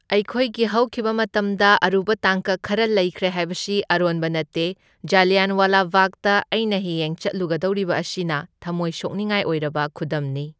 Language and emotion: Manipuri, neutral